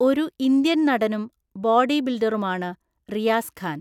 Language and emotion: Malayalam, neutral